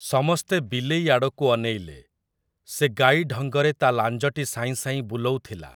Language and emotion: Odia, neutral